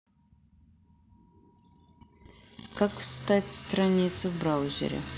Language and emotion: Russian, neutral